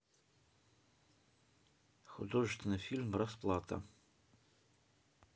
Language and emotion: Russian, neutral